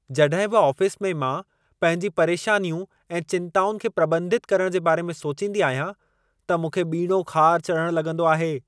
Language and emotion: Sindhi, angry